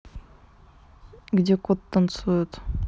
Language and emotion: Russian, neutral